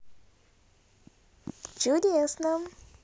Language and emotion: Russian, positive